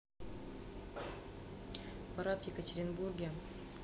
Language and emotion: Russian, neutral